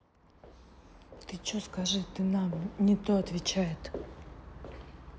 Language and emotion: Russian, angry